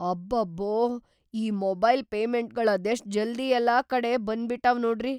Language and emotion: Kannada, surprised